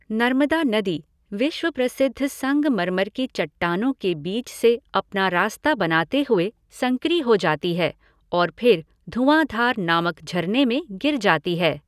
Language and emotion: Hindi, neutral